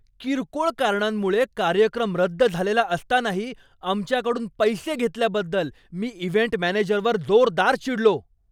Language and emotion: Marathi, angry